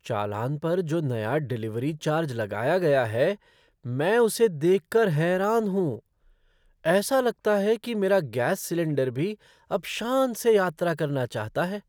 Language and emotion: Hindi, surprised